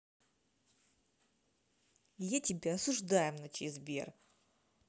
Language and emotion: Russian, angry